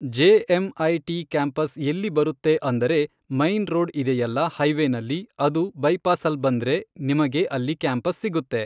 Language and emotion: Kannada, neutral